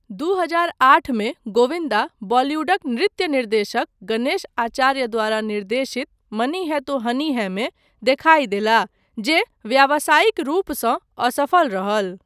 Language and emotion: Maithili, neutral